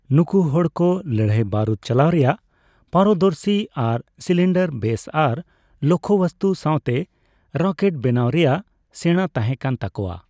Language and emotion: Santali, neutral